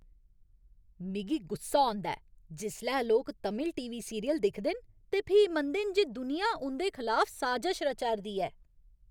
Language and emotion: Dogri, angry